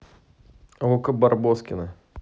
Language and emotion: Russian, neutral